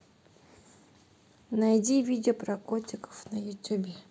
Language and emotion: Russian, neutral